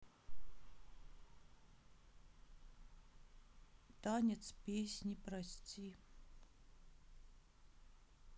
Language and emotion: Russian, sad